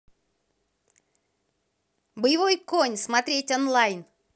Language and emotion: Russian, positive